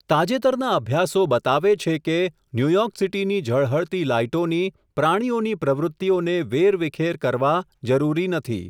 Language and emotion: Gujarati, neutral